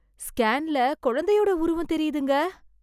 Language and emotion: Tamil, surprised